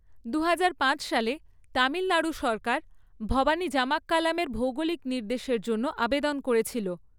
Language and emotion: Bengali, neutral